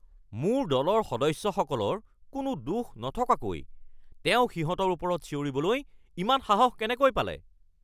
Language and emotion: Assamese, angry